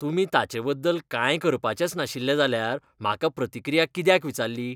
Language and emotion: Goan Konkani, disgusted